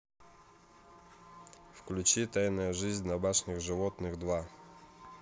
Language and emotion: Russian, neutral